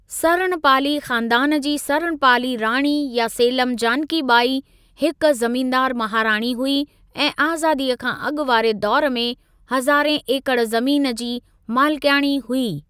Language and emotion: Sindhi, neutral